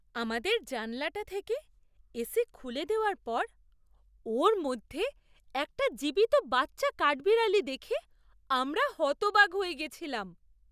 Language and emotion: Bengali, surprised